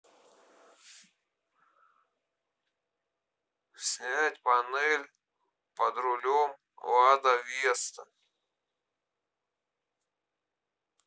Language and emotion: Russian, neutral